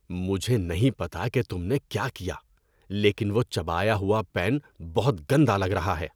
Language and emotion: Urdu, disgusted